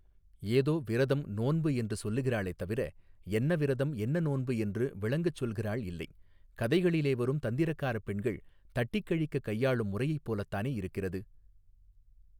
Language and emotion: Tamil, neutral